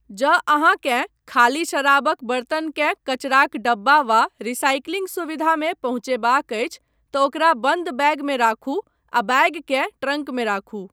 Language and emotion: Maithili, neutral